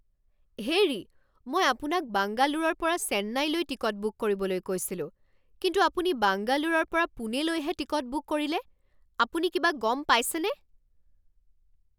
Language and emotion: Assamese, angry